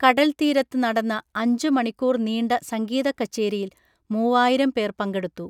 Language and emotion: Malayalam, neutral